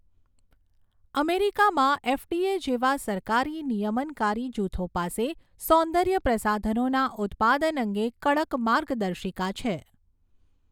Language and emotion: Gujarati, neutral